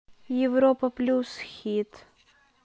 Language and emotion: Russian, neutral